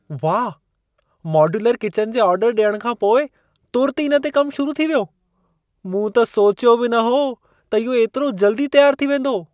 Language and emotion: Sindhi, surprised